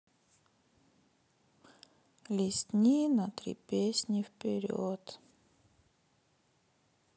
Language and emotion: Russian, sad